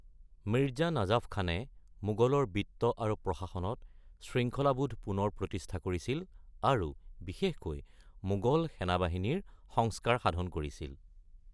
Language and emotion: Assamese, neutral